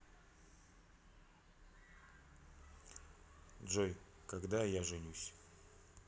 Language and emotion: Russian, sad